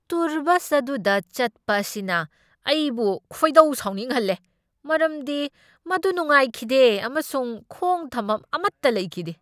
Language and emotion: Manipuri, angry